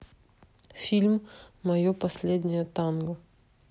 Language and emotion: Russian, neutral